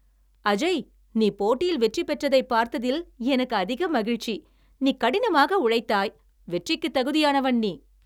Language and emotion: Tamil, happy